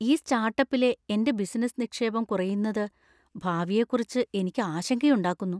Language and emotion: Malayalam, fearful